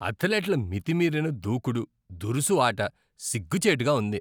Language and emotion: Telugu, disgusted